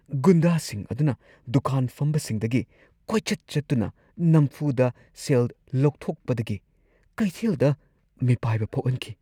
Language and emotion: Manipuri, fearful